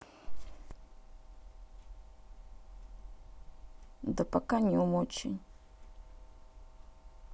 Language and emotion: Russian, sad